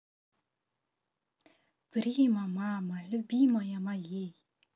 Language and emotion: Russian, positive